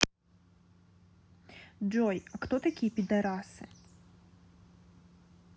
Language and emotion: Russian, neutral